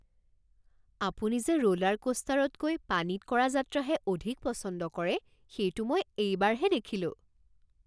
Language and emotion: Assamese, surprised